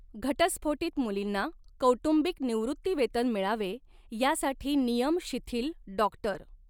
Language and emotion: Marathi, neutral